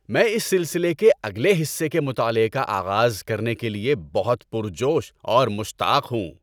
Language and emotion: Urdu, happy